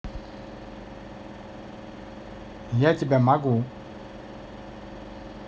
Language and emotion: Russian, neutral